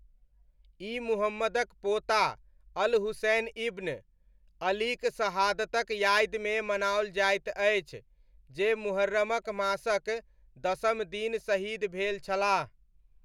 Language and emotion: Maithili, neutral